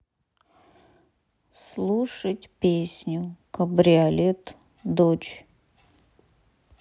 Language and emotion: Russian, sad